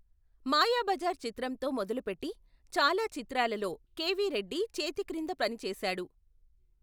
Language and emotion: Telugu, neutral